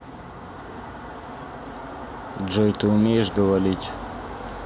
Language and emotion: Russian, neutral